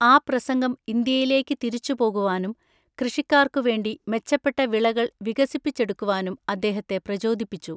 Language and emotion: Malayalam, neutral